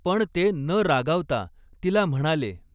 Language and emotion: Marathi, neutral